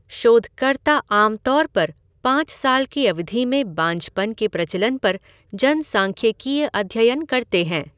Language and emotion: Hindi, neutral